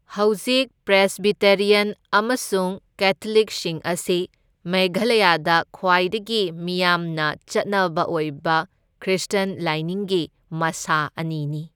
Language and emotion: Manipuri, neutral